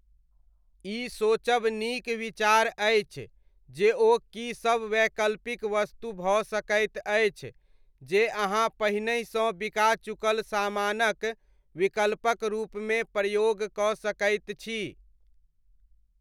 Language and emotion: Maithili, neutral